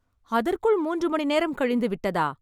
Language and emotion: Tamil, surprised